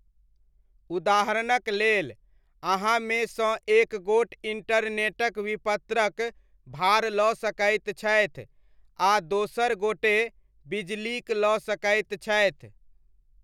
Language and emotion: Maithili, neutral